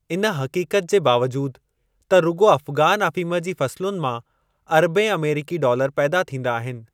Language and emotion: Sindhi, neutral